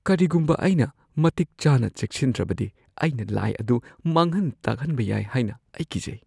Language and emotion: Manipuri, fearful